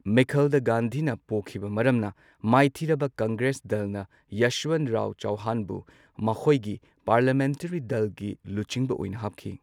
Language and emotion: Manipuri, neutral